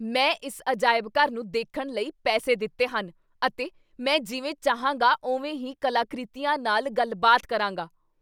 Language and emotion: Punjabi, angry